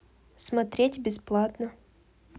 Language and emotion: Russian, neutral